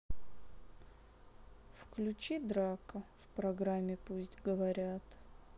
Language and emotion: Russian, sad